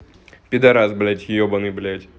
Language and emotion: Russian, angry